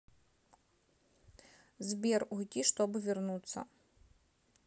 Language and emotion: Russian, neutral